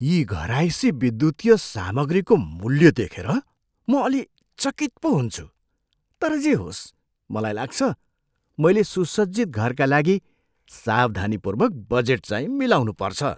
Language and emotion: Nepali, surprised